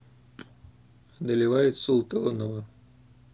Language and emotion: Russian, neutral